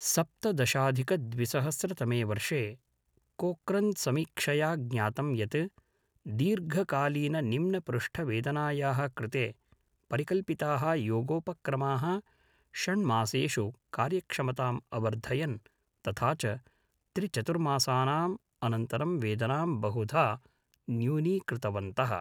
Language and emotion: Sanskrit, neutral